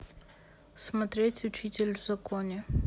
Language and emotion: Russian, neutral